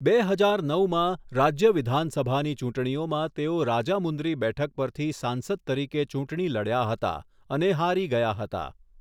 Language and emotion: Gujarati, neutral